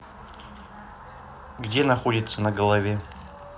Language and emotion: Russian, neutral